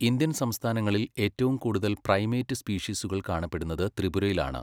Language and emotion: Malayalam, neutral